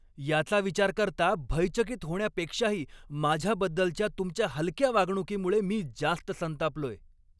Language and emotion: Marathi, angry